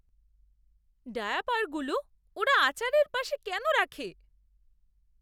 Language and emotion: Bengali, disgusted